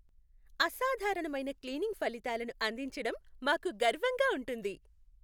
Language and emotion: Telugu, happy